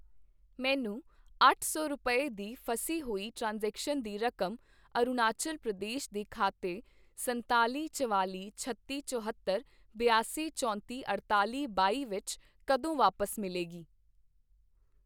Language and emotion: Punjabi, neutral